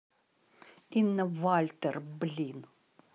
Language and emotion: Russian, angry